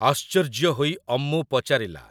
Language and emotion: Odia, neutral